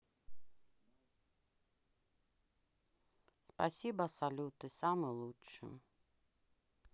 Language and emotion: Russian, sad